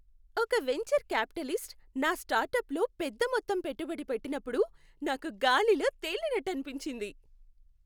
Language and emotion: Telugu, happy